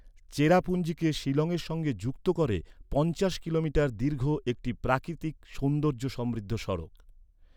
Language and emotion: Bengali, neutral